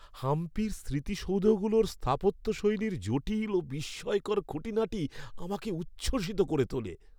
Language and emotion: Bengali, happy